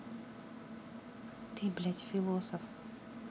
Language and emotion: Russian, angry